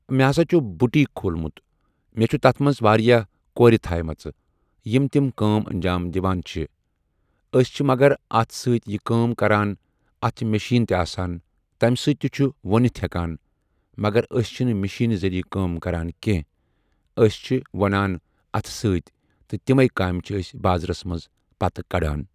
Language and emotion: Kashmiri, neutral